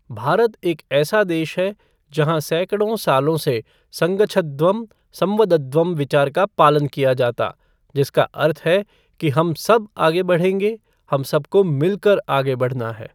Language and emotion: Hindi, neutral